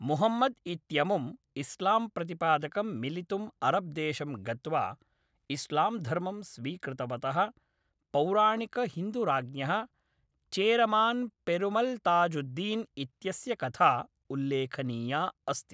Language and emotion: Sanskrit, neutral